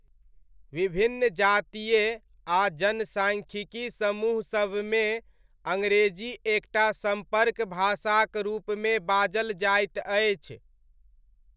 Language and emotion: Maithili, neutral